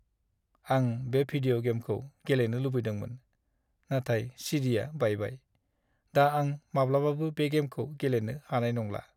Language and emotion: Bodo, sad